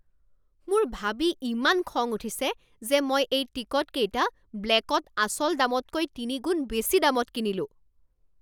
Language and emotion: Assamese, angry